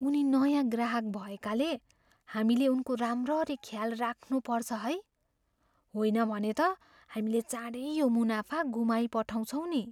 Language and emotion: Nepali, fearful